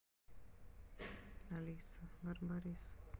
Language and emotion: Russian, neutral